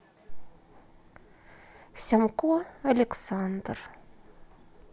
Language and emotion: Russian, sad